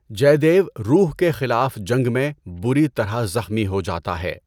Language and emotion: Urdu, neutral